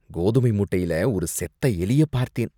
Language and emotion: Tamil, disgusted